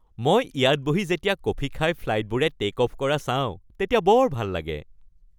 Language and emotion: Assamese, happy